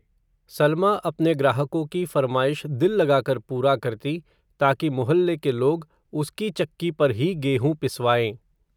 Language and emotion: Hindi, neutral